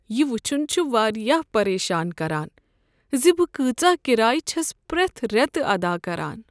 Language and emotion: Kashmiri, sad